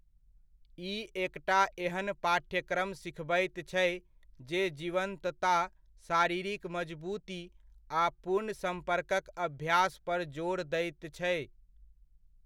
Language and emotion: Maithili, neutral